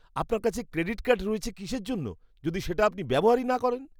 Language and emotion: Bengali, disgusted